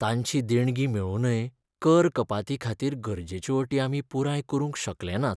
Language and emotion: Goan Konkani, sad